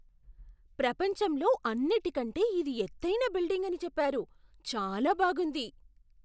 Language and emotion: Telugu, surprised